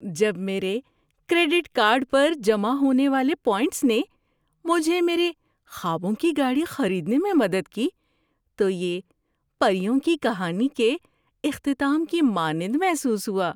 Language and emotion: Urdu, happy